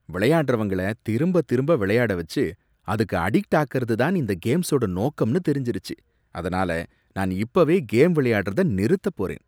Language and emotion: Tamil, disgusted